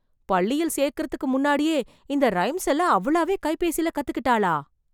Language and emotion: Tamil, surprised